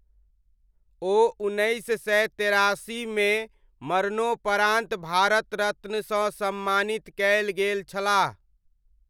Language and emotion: Maithili, neutral